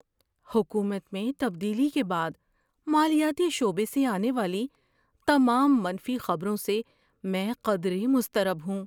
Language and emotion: Urdu, fearful